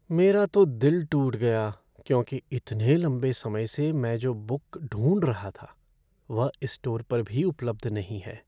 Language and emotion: Hindi, sad